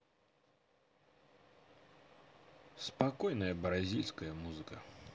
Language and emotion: Russian, neutral